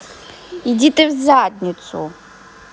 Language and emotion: Russian, angry